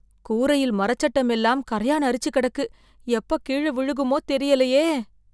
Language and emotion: Tamil, fearful